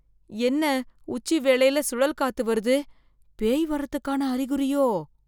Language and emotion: Tamil, fearful